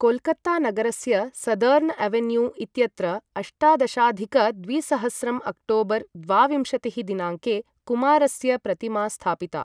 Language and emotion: Sanskrit, neutral